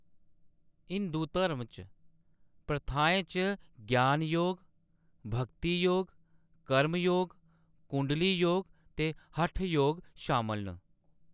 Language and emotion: Dogri, neutral